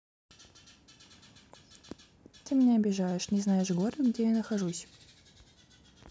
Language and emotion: Russian, neutral